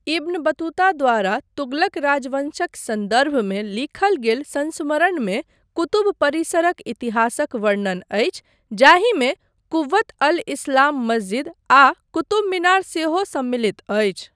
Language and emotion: Maithili, neutral